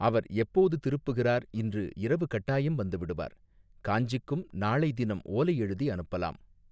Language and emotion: Tamil, neutral